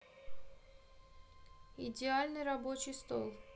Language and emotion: Russian, neutral